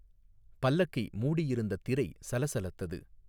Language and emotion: Tamil, neutral